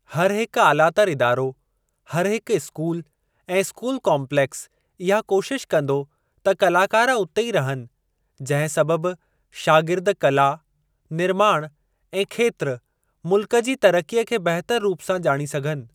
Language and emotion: Sindhi, neutral